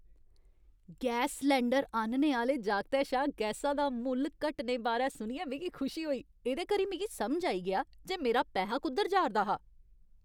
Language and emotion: Dogri, happy